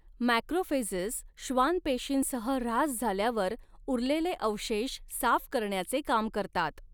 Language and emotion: Marathi, neutral